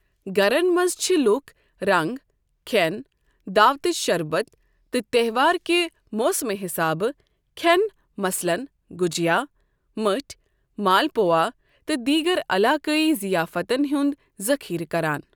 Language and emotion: Kashmiri, neutral